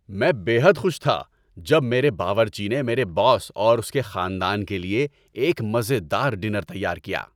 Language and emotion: Urdu, happy